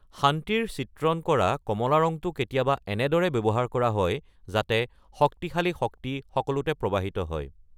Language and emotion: Assamese, neutral